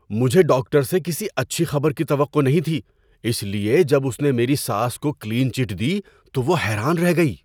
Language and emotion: Urdu, surprised